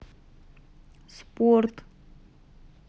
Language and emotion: Russian, neutral